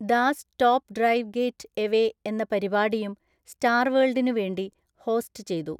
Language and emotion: Malayalam, neutral